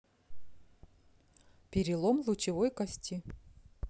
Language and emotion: Russian, neutral